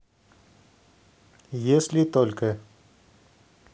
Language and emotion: Russian, neutral